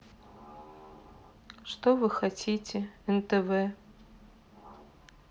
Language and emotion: Russian, sad